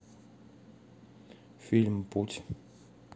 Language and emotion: Russian, neutral